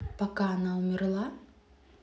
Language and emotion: Russian, neutral